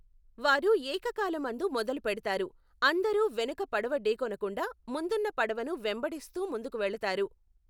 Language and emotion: Telugu, neutral